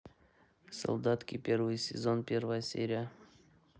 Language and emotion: Russian, neutral